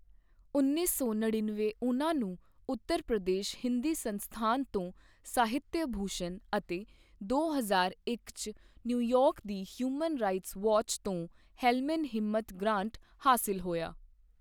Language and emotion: Punjabi, neutral